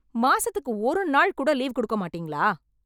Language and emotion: Tamil, angry